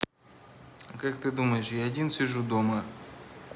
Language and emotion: Russian, neutral